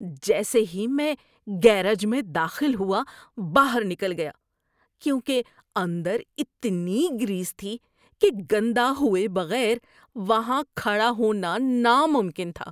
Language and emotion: Urdu, disgusted